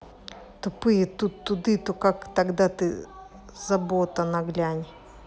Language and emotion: Russian, angry